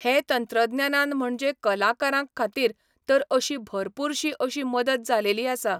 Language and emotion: Goan Konkani, neutral